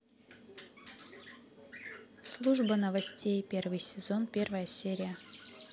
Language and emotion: Russian, neutral